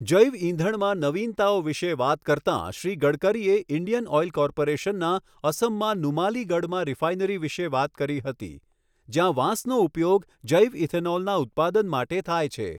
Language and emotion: Gujarati, neutral